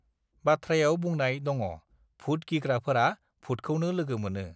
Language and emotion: Bodo, neutral